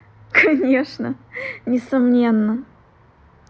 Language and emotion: Russian, positive